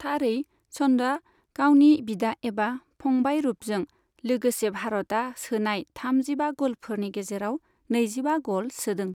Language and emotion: Bodo, neutral